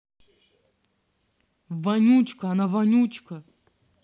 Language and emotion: Russian, angry